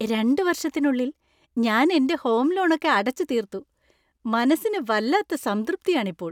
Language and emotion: Malayalam, happy